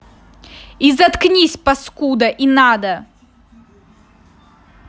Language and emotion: Russian, angry